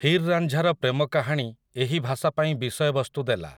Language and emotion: Odia, neutral